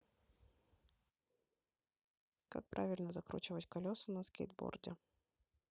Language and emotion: Russian, neutral